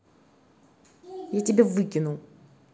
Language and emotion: Russian, angry